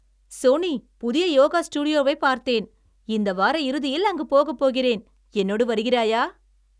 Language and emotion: Tamil, happy